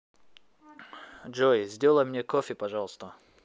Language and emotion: Russian, positive